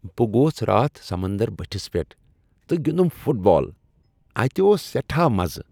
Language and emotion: Kashmiri, happy